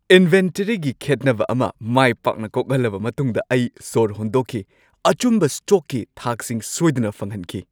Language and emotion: Manipuri, happy